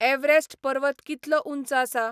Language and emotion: Goan Konkani, neutral